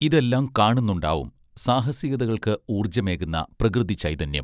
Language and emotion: Malayalam, neutral